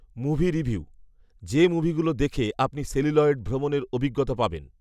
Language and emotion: Bengali, neutral